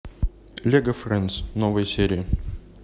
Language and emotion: Russian, neutral